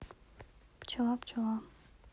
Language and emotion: Russian, neutral